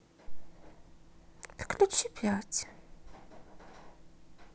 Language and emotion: Russian, neutral